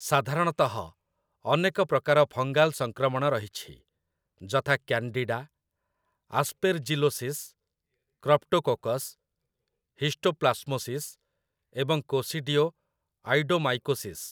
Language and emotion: Odia, neutral